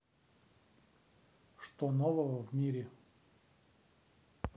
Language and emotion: Russian, neutral